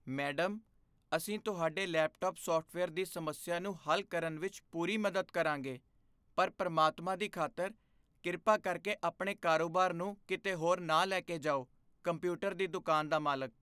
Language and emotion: Punjabi, fearful